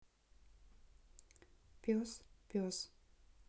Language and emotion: Russian, neutral